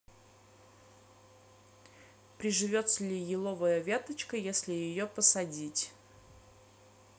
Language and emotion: Russian, neutral